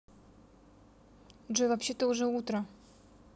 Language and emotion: Russian, neutral